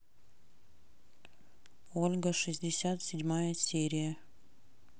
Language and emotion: Russian, neutral